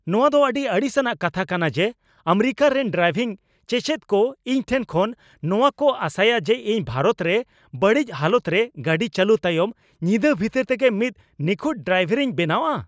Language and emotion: Santali, angry